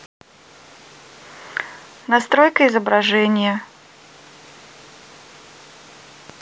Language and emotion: Russian, neutral